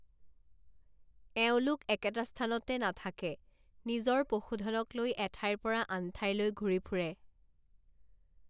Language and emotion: Assamese, neutral